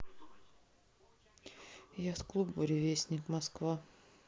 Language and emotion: Russian, sad